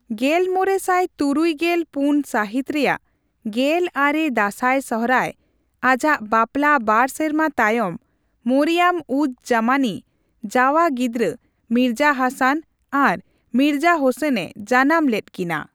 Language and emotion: Santali, neutral